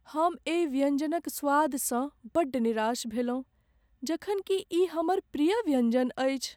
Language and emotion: Maithili, sad